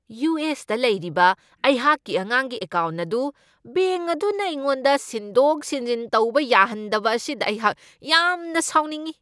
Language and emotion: Manipuri, angry